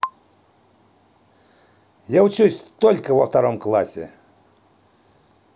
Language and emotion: Russian, positive